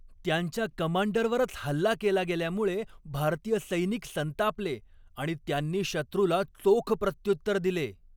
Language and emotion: Marathi, angry